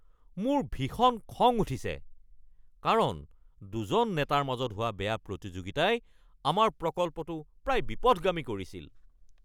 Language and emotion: Assamese, angry